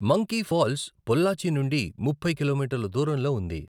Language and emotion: Telugu, neutral